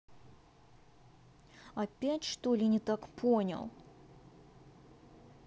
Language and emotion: Russian, angry